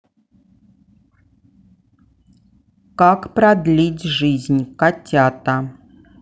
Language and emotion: Russian, neutral